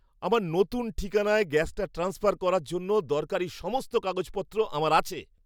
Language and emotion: Bengali, happy